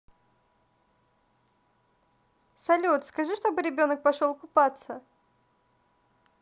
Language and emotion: Russian, positive